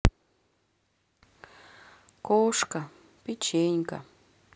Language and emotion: Russian, sad